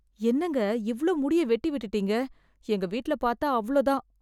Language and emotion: Tamil, fearful